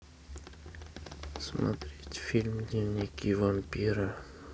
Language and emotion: Russian, neutral